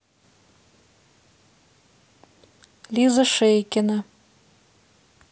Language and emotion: Russian, neutral